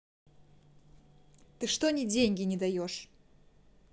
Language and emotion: Russian, angry